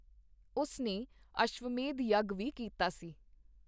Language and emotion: Punjabi, neutral